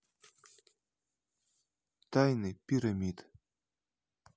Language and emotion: Russian, neutral